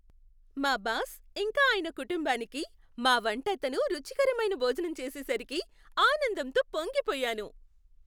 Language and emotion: Telugu, happy